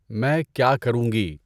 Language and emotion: Urdu, neutral